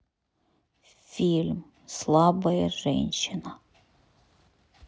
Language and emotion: Russian, sad